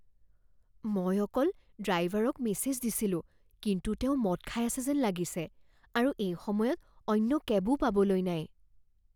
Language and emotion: Assamese, fearful